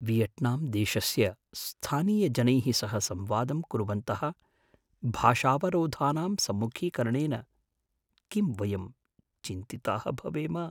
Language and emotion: Sanskrit, fearful